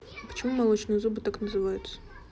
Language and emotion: Russian, neutral